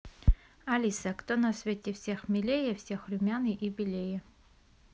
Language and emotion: Russian, neutral